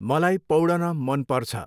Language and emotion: Nepali, neutral